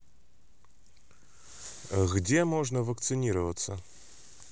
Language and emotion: Russian, neutral